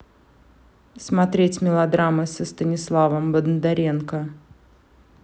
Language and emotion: Russian, neutral